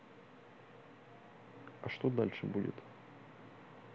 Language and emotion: Russian, neutral